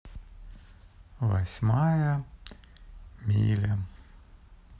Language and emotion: Russian, sad